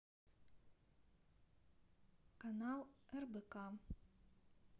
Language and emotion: Russian, neutral